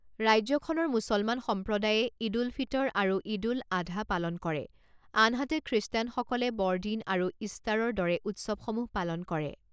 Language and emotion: Assamese, neutral